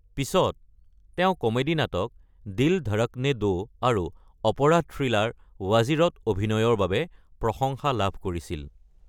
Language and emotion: Assamese, neutral